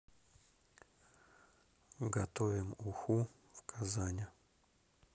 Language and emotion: Russian, neutral